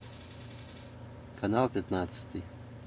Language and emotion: Russian, neutral